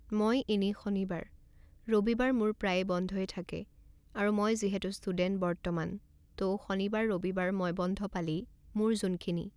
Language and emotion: Assamese, neutral